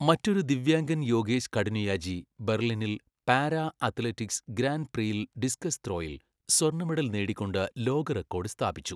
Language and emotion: Malayalam, neutral